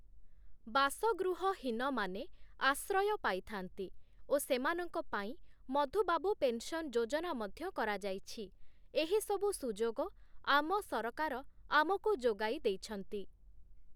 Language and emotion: Odia, neutral